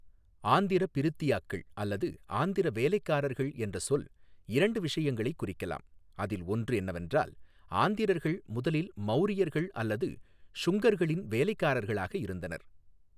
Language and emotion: Tamil, neutral